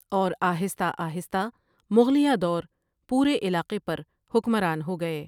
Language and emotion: Urdu, neutral